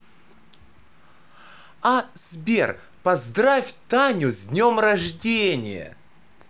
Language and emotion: Russian, positive